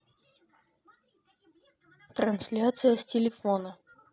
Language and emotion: Russian, neutral